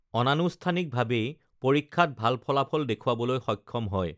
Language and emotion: Assamese, neutral